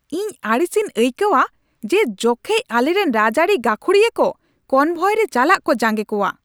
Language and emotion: Santali, angry